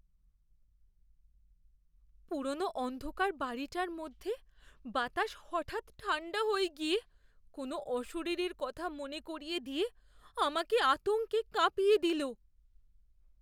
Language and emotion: Bengali, fearful